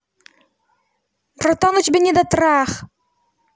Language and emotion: Russian, angry